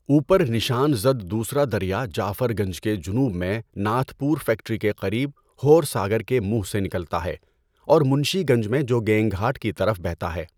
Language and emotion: Urdu, neutral